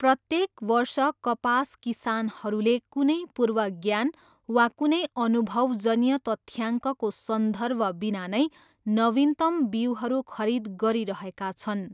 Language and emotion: Nepali, neutral